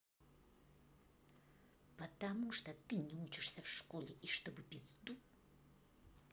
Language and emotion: Russian, angry